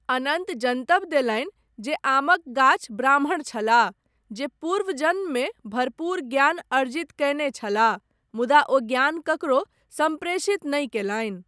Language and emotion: Maithili, neutral